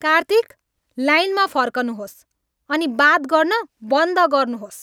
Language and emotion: Nepali, angry